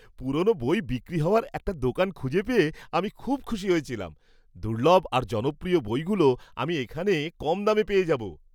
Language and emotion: Bengali, happy